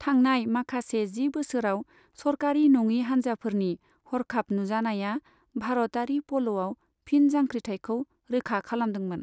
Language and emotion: Bodo, neutral